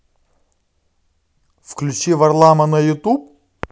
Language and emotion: Russian, positive